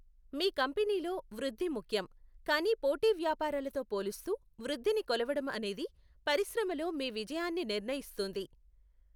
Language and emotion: Telugu, neutral